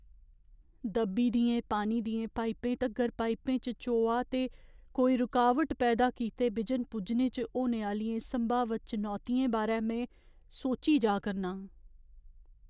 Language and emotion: Dogri, fearful